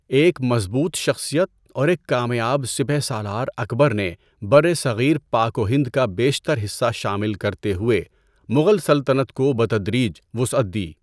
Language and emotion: Urdu, neutral